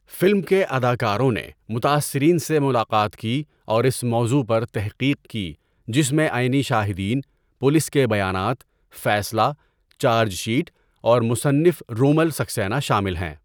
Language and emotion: Urdu, neutral